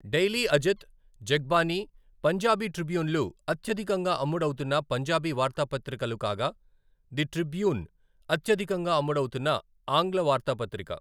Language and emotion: Telugu, neutral